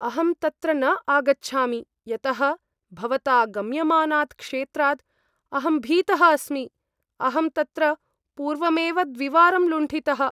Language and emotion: Sanskrit, fearful